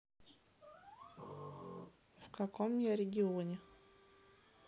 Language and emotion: Russian, neutral